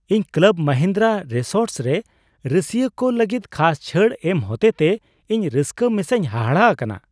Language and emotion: Santali, surprised